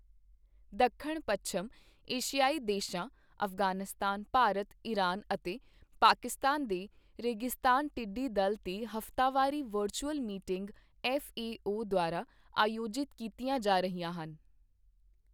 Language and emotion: Punjabi, neutral